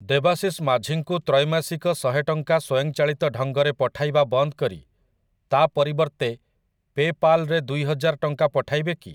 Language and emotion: Odia, neutral